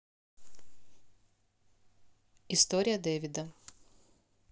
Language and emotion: Russian, neutral